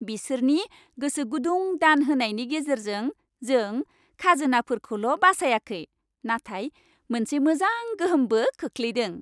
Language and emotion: Bodo, happy